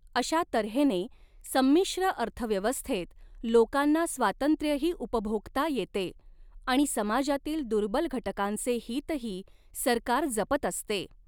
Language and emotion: Marathi, neutral